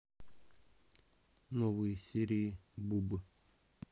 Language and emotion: Russian, neutral